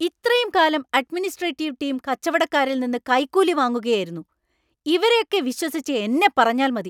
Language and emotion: Malayalam, angry